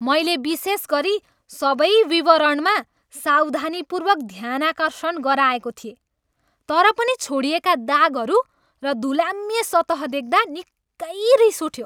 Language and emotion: Nepali, angry